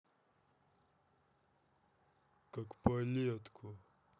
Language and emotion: Russian, angry